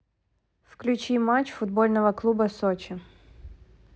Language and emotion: Russian, neutral